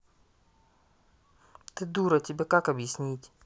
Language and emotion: Russian, angry